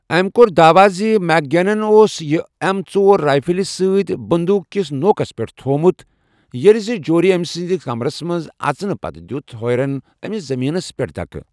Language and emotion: Kashmiri, neutral